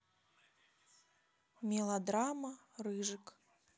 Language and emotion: Russian, neutral